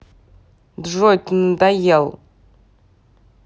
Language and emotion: Russian, angry